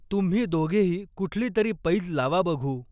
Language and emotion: Marathi, neutral